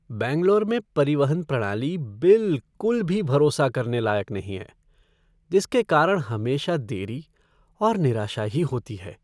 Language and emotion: Hindi, sad